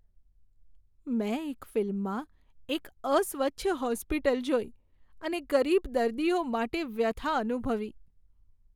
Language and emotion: Gujarati, sad